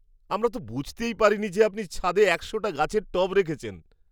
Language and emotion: Bengali, surprised